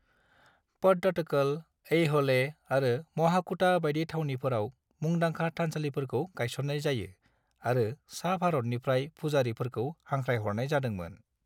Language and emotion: Bodo, neutral